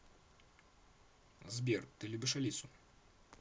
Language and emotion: Russian, neutral